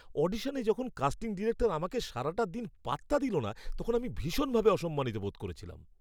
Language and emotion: Bengali, angry